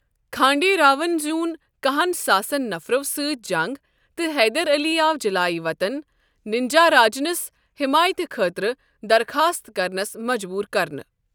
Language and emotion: Kashmiri, neutral